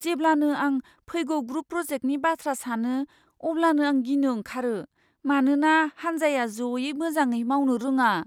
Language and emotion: Bodo, fearful